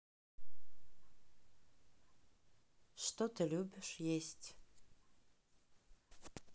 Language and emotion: Russian, neutral